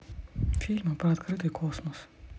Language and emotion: Russian, neutral